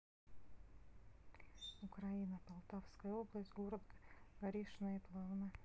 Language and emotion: Russian, sad